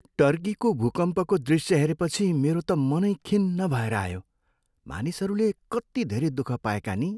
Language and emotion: Nepali, sad